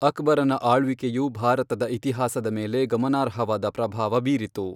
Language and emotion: Kannada, neutral